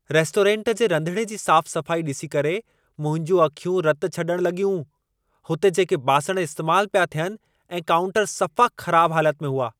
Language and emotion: Sindhi, angry